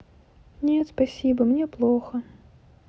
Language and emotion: Russian, neutral